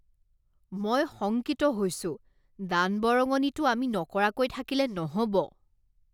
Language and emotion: Assamese, disgusted